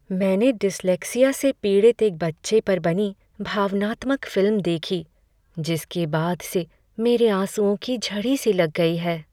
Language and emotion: Hindi, sad